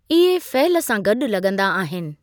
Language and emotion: Sindhi, neutral